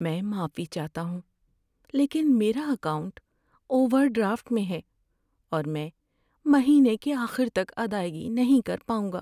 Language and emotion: Urdu, sad